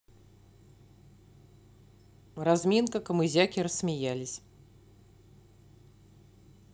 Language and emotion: Russian, neutral